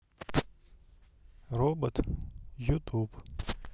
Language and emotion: Russian, neutral